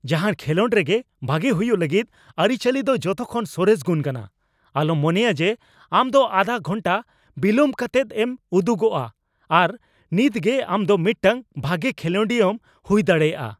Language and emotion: Santali, angry